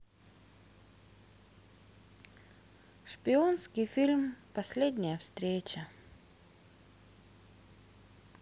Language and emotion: Russian, sad